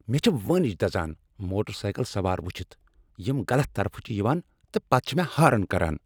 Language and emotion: Kashmiri, angry